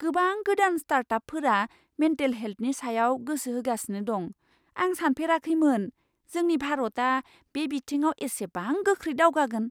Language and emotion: Bodo, surprised